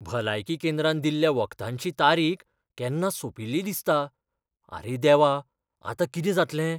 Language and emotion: Goan Konkani, fearful